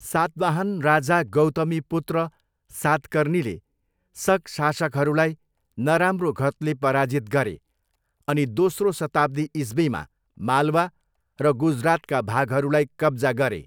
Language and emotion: Nepali, neutral